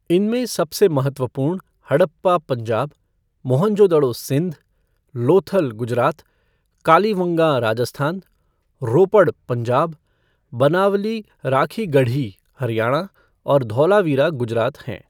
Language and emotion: Hindi, neutral